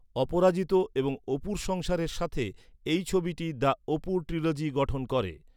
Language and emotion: Bengali, neutral